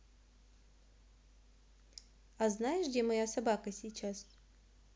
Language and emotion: Russian, neutral